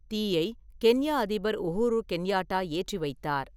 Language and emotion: Tamil, neutral